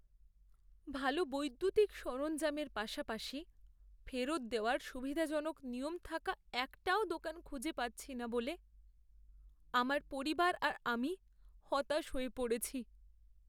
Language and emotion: Bengali, sad